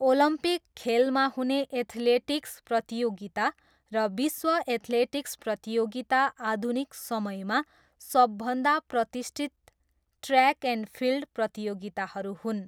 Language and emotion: Nepali, neutral